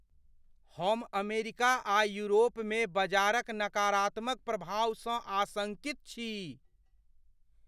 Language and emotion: Maithili, fearful